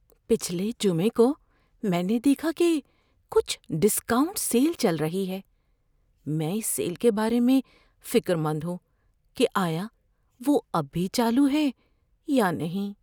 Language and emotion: Urdu, fearful